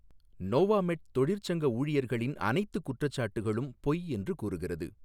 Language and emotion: Tamil, neutral